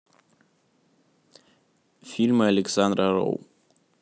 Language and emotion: Russian, neutral